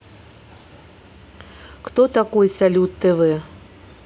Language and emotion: Russian, neutral